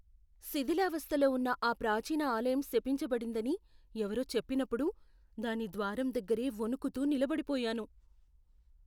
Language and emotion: Telugu, fearful